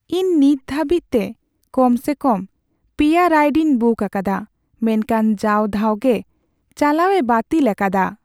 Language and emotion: Santali, sad